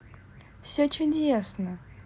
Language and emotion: Russian, positive